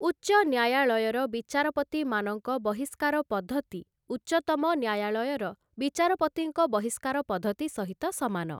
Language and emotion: Odia, neutral